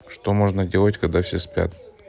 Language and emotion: Russian, neutral